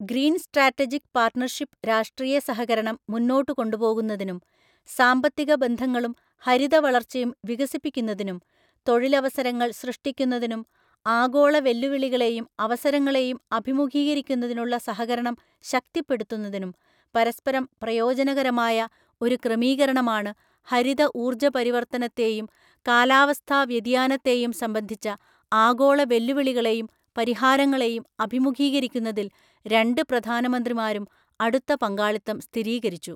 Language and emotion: Malayalam, neutral